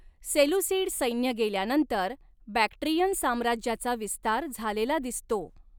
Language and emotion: Marathi, neutral